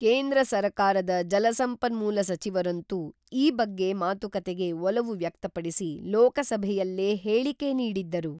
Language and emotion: Kannada, neutral